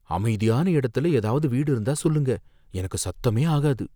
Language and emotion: Tamil, fearful